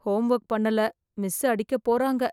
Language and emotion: Tamil, fearful